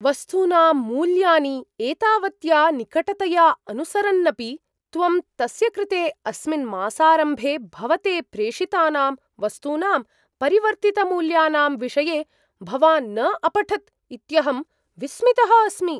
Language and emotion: Sanskrit, surprised